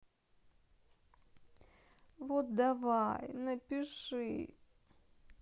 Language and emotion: Russian, sad